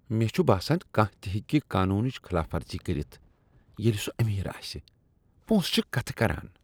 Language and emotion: Kashmiri, disgusted